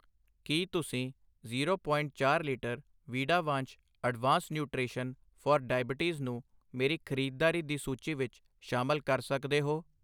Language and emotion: Punjabi, neutral